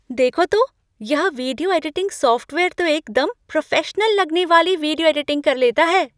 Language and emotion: Hindi, surprised